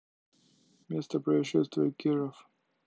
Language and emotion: Russian, neutral